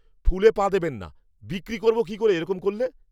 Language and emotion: Bengali, angry